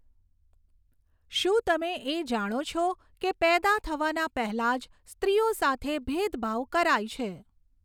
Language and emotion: Gujarati, neutral